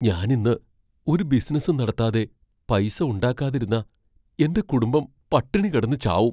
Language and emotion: Malayalam, fearful